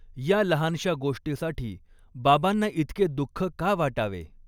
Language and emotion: Marathi, neutral